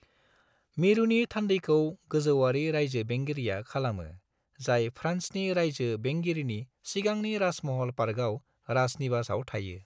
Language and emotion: Bodo, neutral